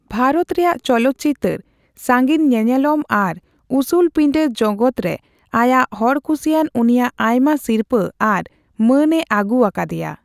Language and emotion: Santali, neutral